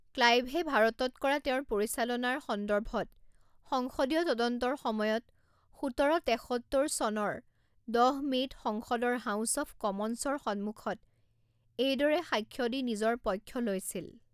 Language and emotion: Assamese, neutral